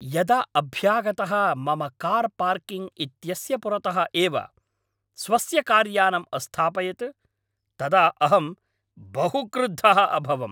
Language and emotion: Sanskrit, angry